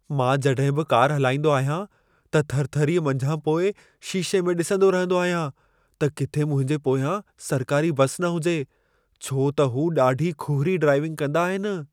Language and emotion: Sindhi, fearful